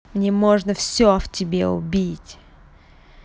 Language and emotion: Russian, angry